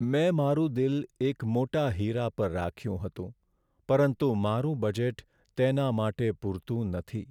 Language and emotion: Gujarati, sad